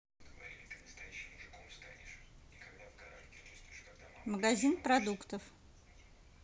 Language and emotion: Russian, neutral